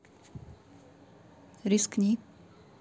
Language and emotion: Russian, neutral